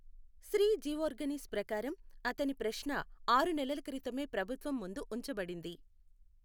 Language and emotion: Telugu, neutral